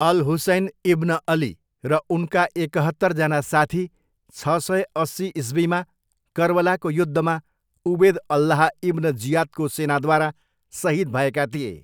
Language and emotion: Nepali, neutral